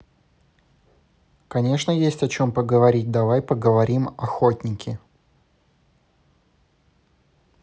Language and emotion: Russian, neutral